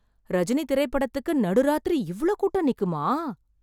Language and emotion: Tamil, surprised